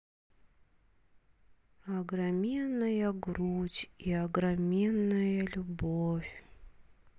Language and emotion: Russian, sad